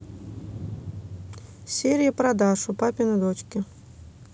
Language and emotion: Russian, neutral